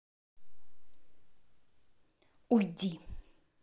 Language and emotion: Russian, angry